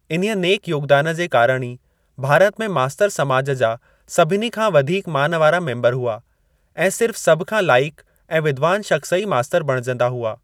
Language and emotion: Sindhi, neutral